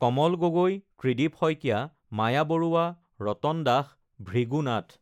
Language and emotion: Assamese, neutral